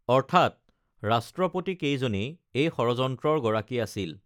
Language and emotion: Assamese, neutral